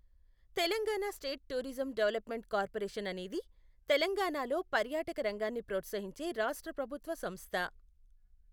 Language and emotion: Telugu, neutral